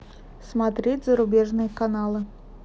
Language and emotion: Russian, neutral